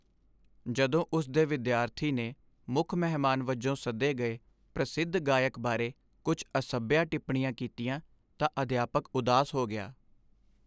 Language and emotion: Punjabi, sad